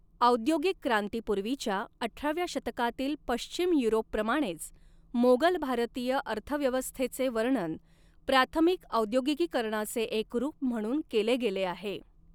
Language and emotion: Marathi, neutral